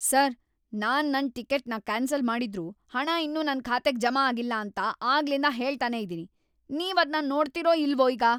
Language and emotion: Kannada, angry